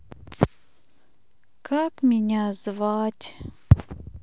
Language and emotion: Russian, sad